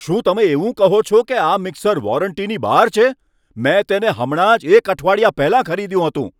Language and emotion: Gujarati, angry